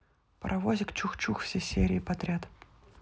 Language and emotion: Russian, neutral